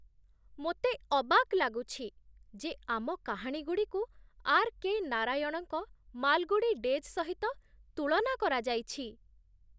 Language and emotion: Odia, surprised